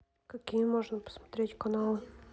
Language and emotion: Russian, neutral